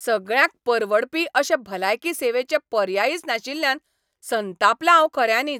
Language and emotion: Goan Konkani, angry